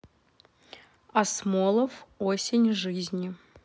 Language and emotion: Russian, neutral